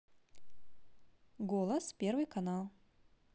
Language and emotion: Russian, positive